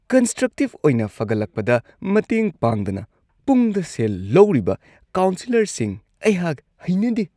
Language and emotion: Manipuri, disgusted